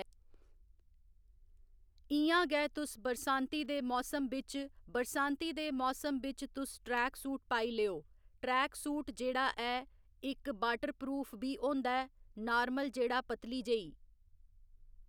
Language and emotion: Dogri, neutral